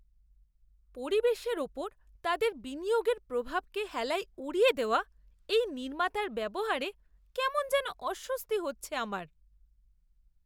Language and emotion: Bengali, disgusted